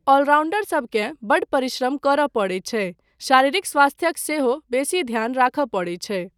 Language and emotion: Maithili, neutral